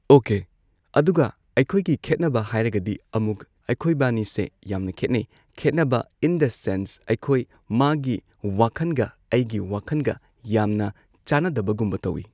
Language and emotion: Manipuri, neutral